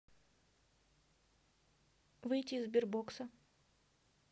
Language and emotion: Russian, neutral